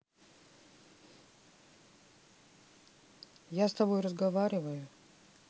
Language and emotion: Russian, neutral